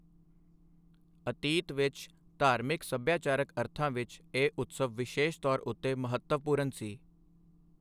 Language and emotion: Punjabi, neutral